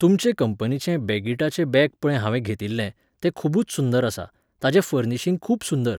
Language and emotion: Goan Konkani, neutral